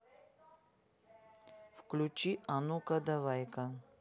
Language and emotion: Russian, neutral